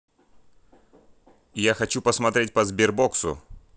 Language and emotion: Russian, angry